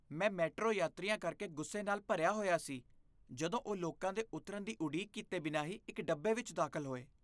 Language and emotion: Punjabi, disgusted